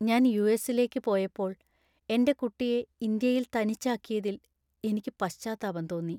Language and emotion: Malayalam, sad